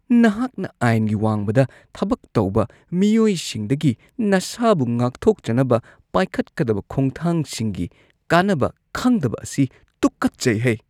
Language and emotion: Manipuri, disgusted